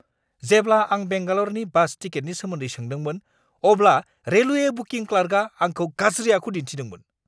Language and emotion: Bodo, angry